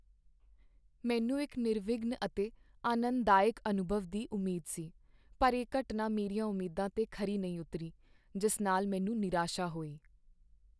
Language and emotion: Punjabi, sad